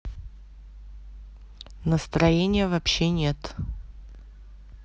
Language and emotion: Russian, neutral